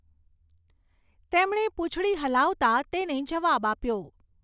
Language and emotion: Gujarati, neutral